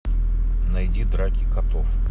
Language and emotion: Russian, neutral